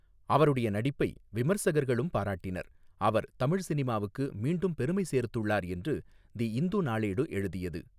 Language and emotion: Tamil, neutral